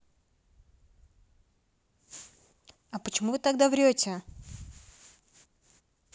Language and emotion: Russian, neutral